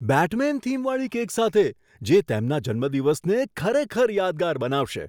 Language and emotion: Gujarati, surprised